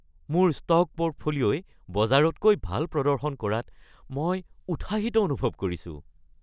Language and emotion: Assamese, happy